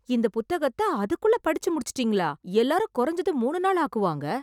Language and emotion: Tamil, surprised